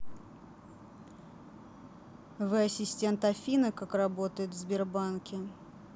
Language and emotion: Russian, neutral